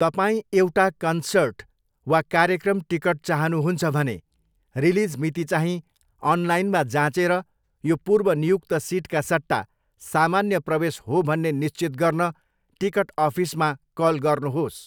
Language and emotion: Nepali, neutral